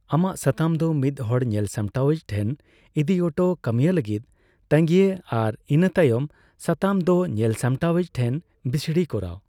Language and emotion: Santali, neutral